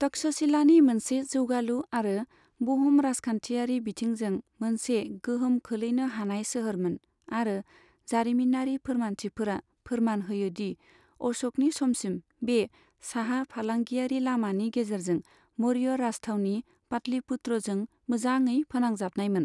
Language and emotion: Bodo, neutral